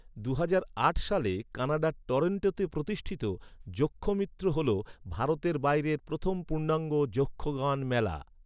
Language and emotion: Bengali, neutral